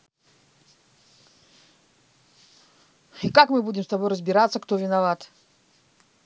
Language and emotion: Russian, angry